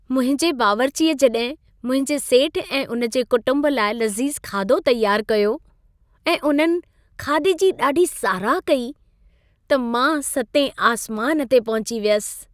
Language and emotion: Sindhi, happy